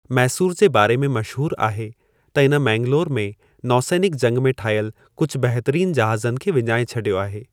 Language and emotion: Sindhi, neutral